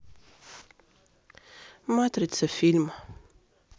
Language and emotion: Russian, sad